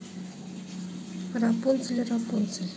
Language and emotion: Russian, neutral